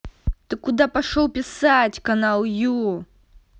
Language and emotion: Russian, angry